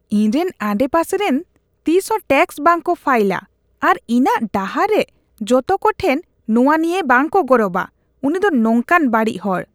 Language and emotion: Santali, disgusted